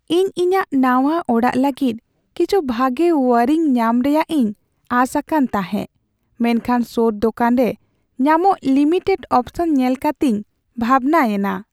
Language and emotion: Santali, sad